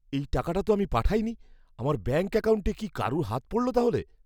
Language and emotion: Bengali, fearful